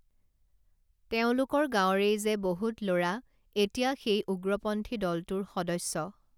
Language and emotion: Assamese, neutral